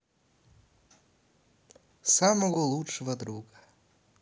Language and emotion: Russian, neutral